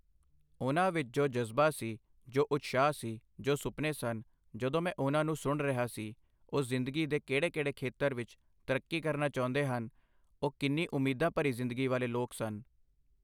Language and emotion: Punjabi, neutral